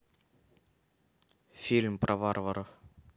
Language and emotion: Russian, neutral